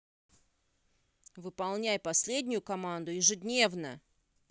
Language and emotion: Russian, angry